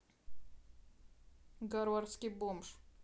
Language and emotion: Russian, neutral